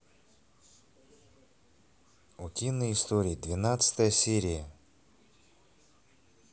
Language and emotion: Russian, neutral